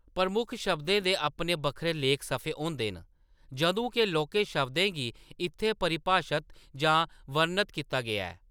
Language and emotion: Dogri, neutral